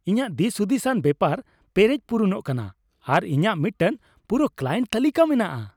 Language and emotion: Santali, happy